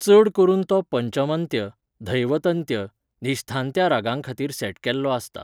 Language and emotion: Goan Konkani, neutral